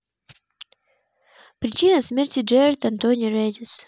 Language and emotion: Russian, neutral